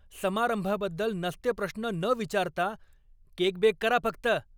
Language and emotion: Marathi, angry